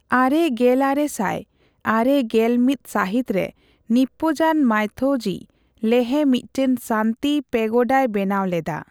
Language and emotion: Santali, neutral